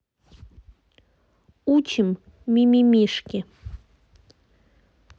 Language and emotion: Russian, neutral